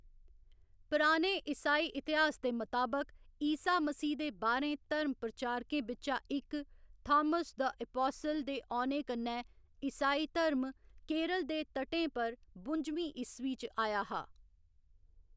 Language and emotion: Dogri, neutral